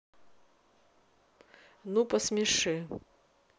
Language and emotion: Russian, neutral